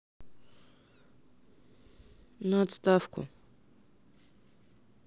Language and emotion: Russian, sad